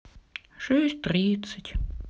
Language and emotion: Russian, sad